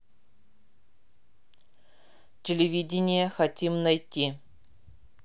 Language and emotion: Russian, neutral